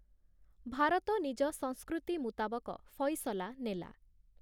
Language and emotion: Odia, neutral